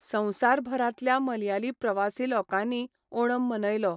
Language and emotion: Goan Konkani, neutral